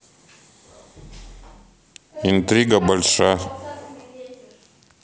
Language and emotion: Russian, neutral